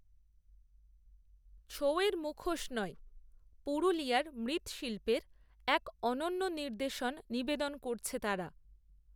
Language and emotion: Bengali, neutral